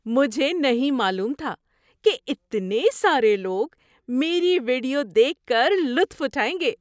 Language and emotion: Urdu, surprised